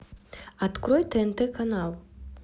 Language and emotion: Russian, neutral